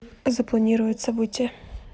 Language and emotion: Russian, neutral